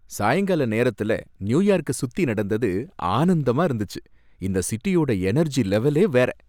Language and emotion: Tamil, happy